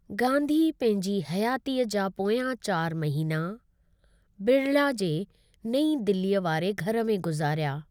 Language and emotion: Sindhi, neutral